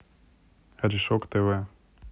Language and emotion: Russian, neutral